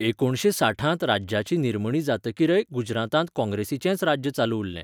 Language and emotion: Goan Konkani, neutral